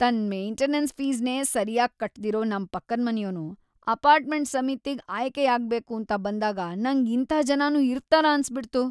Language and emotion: Kannada, disgusted